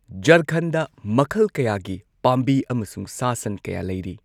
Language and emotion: Manipuri, neutral